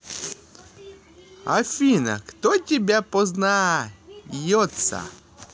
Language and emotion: Russian, positive